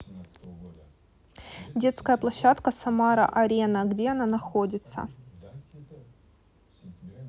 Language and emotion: Russian, neutral